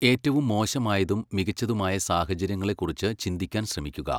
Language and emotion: Malayalam, neutral